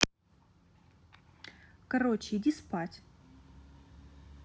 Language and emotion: Russian, neutral